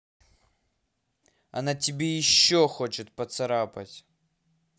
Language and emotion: Russian, angry